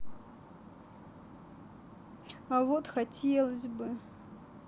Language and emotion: Russian, sad